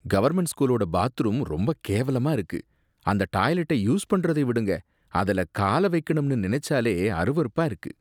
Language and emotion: Tamil, disgusted